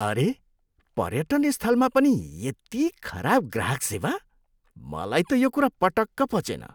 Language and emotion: Nepali, disgusted